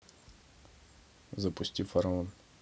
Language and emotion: Russian, neutral